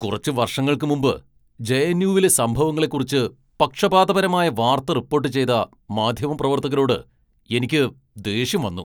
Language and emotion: Malayalam, angry